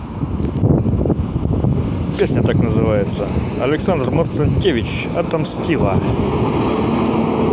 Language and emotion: Russian, positive